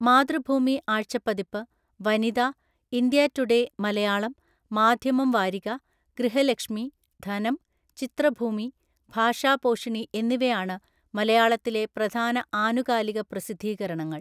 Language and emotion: Malayalam, neutral